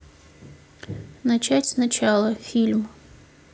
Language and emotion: Russian, neutral